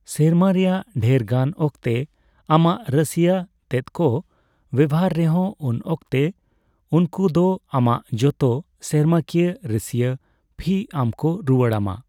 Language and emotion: Santali, neutral